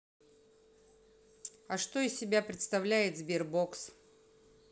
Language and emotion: Russian, neutral